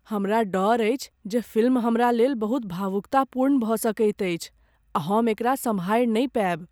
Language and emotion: Maithili, fearful